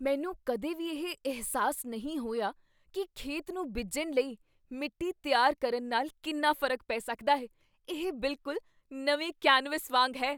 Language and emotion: Punjabi, surprised